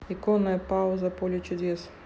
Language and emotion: Russian, neutral